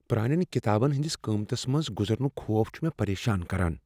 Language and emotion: Kashmiri, fearful